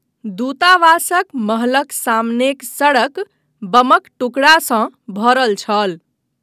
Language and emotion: Maithili, neutral